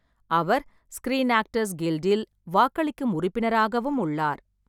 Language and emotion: Tamil, neutral